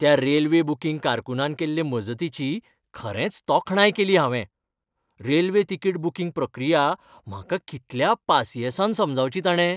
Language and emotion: Goan Konkani, happy